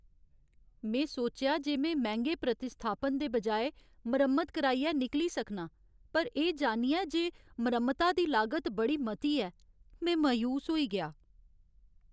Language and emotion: Dogri, sad